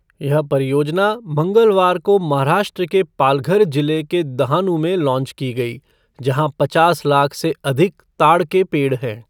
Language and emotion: Hindi, neutral